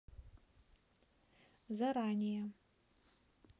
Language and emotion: Russian, neutral